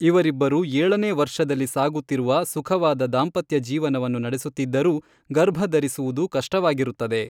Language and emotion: Kannada, neutral